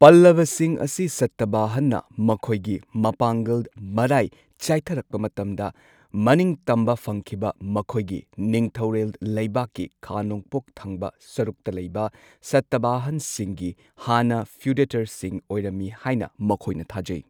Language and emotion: Manipuri, neutral